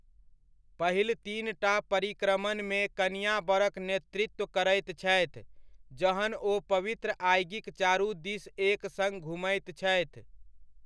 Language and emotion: Maithili, neutral